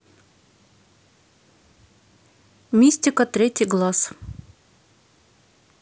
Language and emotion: Russian, neutral